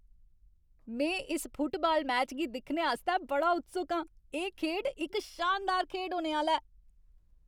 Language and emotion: Dogri, happy